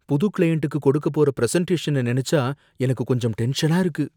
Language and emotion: Tamil, fearful